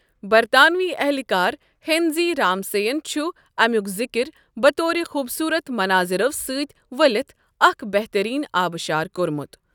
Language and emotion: Kashmiri, neutral